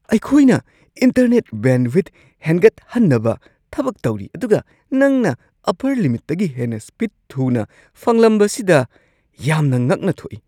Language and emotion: Manipuri, surprised